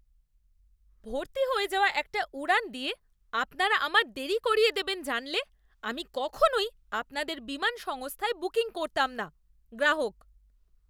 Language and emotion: Bengali, disgusted